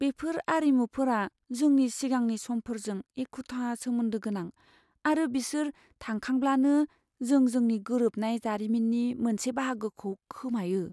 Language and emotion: Bodo, fearful